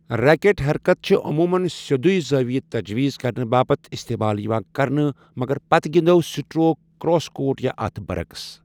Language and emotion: Kashmiri, neutral